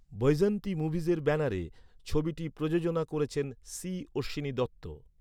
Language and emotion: Bengali, neutral